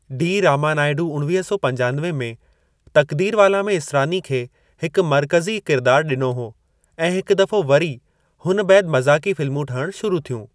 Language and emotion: Sindhi, neutral